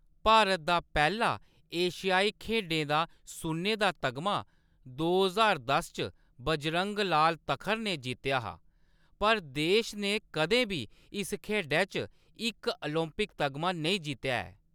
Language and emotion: Dogri, neutral